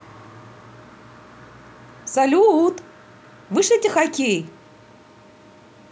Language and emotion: Russian, positive